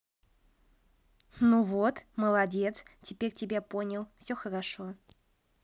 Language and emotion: Russian, positive